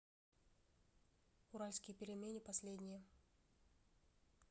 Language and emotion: Russian, neutral